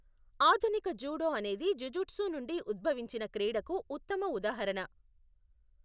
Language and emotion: Telugu, neutral